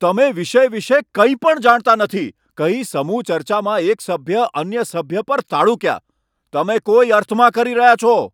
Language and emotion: Gujarati, angry